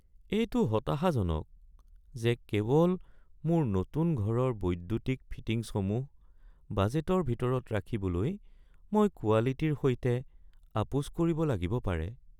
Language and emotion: Assamese, sad